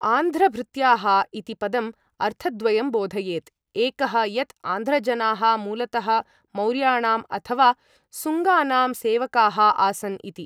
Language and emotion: Sanskrit, neutral